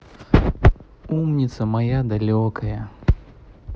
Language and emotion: Russian, positive